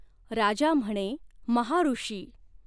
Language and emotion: Marathi, neutral